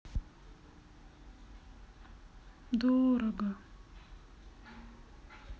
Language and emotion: Russian, sad